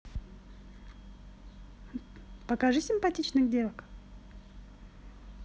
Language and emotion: Russian, positive